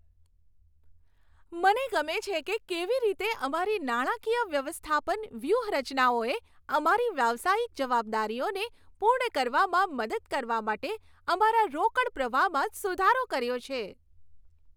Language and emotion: Gujarati, happy